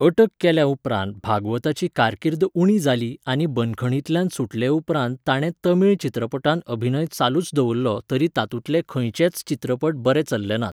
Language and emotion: Goan Konkani, neutral